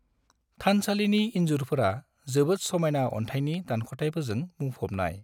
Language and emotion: Bodo, neutral